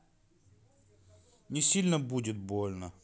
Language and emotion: Russian, sad